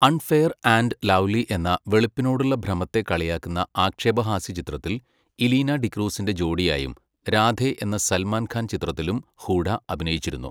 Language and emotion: Malayalam, neutral